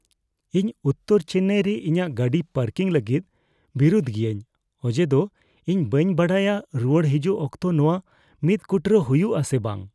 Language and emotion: Santali, fearful